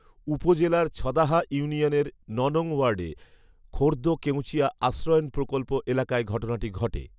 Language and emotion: Bengali, neutral